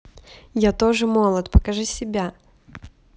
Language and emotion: Russian, positive